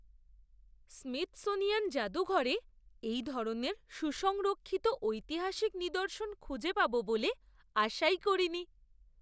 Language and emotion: Bengali, surprised